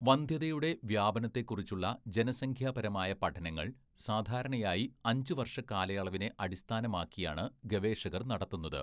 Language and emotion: Malayalam, neutral